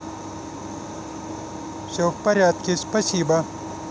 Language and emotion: Russian, neutral